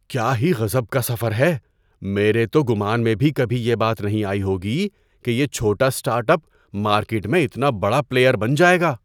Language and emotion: Urdu, surprised